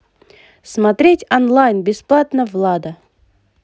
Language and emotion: Russian, positive